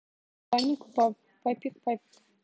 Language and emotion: Russian, neutral